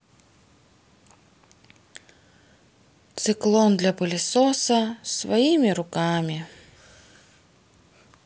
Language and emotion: Russian, sad